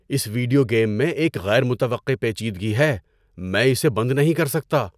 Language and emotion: Urdu, surprised